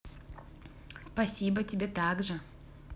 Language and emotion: Russian, positive